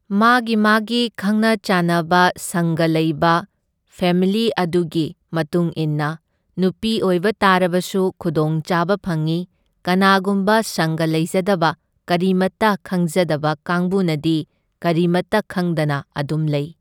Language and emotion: Manipuri, neutral